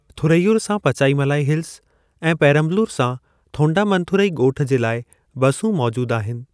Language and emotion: Sindhi, neutral